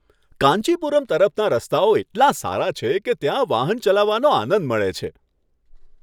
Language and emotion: Gujarati, happy